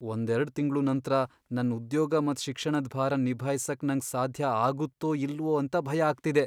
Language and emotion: Kannada, fearful